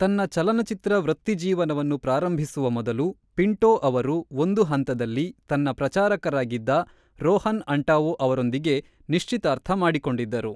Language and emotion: Kannada, neutral